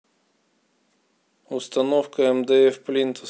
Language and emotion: Russian, neutral